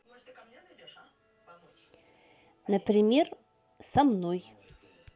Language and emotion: Russian, neutral